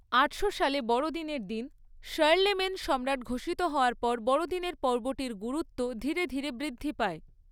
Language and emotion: Bengali, neutral